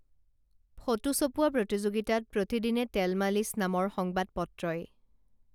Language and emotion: Assamese, neutral